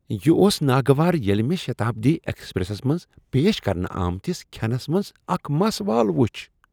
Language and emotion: Kashmiri, disgusted